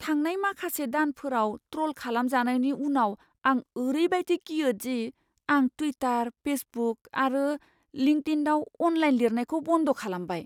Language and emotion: Bodo, fearful